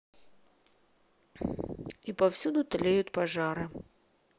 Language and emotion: Russian, neutral